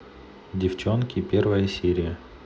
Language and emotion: Russian, neutral